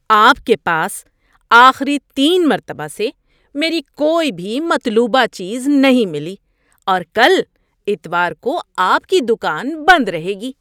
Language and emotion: Urdu, disgusted